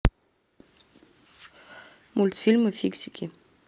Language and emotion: Russian, neutral